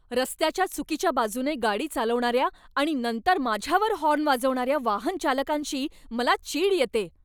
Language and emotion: Marathi, angry